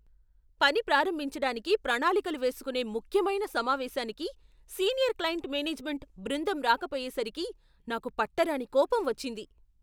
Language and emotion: Telugu, angry